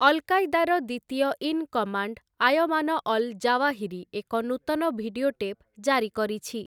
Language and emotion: Odia, neutral